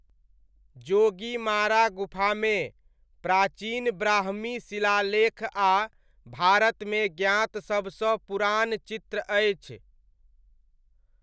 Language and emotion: Maithili, neutral